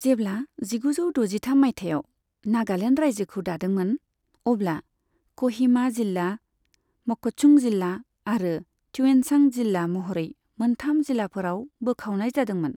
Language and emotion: Bodo, neutral